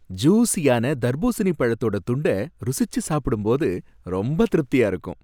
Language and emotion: Tamil, happy